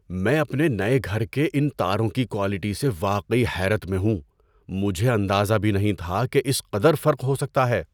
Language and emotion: Urdu, surprised